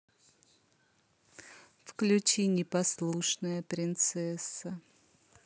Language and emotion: Russian, neutral